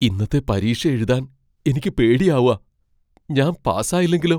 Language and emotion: Malayalam, fearful